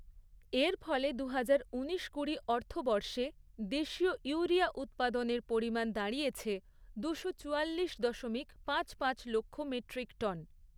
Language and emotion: Bengali, neutral